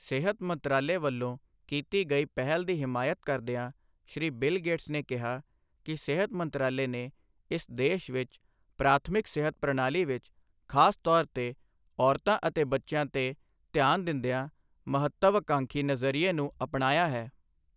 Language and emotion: Punjabi, neutral